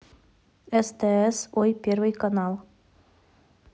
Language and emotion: Russian, neutral